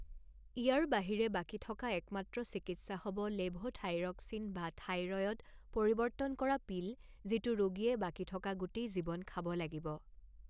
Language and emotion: Assamese, neutral